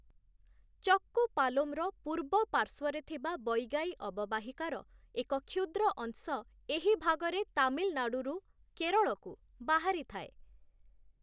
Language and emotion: Odia, neutral